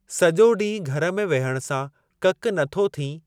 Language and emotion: Sindhi, neutral